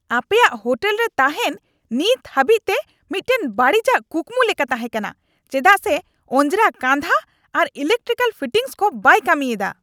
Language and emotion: Santali, angry